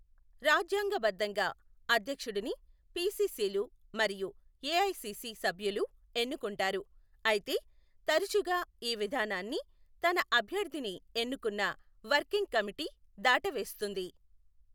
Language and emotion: Telugu, neutral